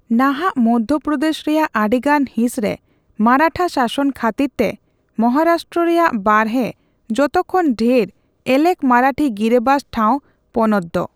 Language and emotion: Santali, neutral